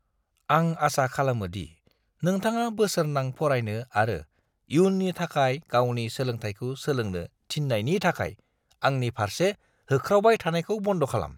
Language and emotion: Bodo, disgusted